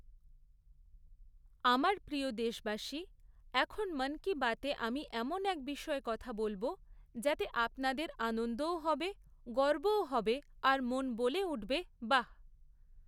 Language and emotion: Bengali, neutral